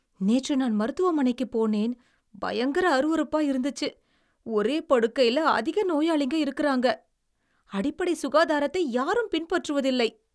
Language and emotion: Tamil, disgusted